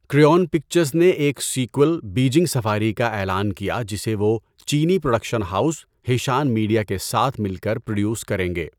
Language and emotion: Urdu, neutral